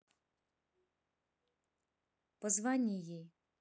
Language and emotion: Russian, neutral